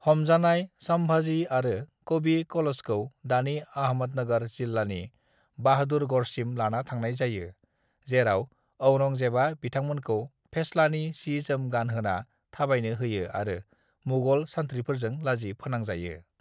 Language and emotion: Bodo, neutral